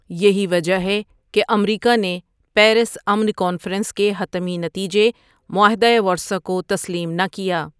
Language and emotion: Urdu, neutral